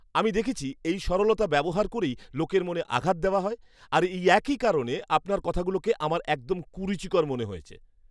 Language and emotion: Bengali, disgusted